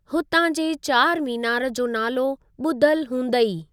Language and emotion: Sindhi, neutral